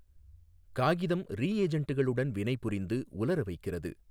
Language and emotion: Tamil, neutral